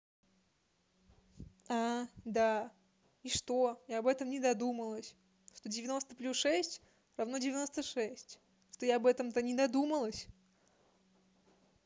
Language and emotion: Russian, neutral